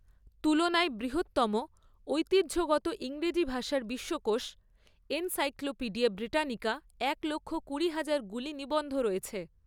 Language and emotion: Bengali, neutral